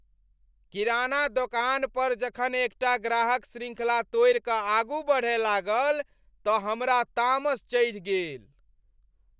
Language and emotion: Maithili, angry